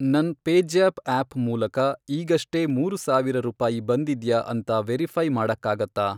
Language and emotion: Kannada, neutral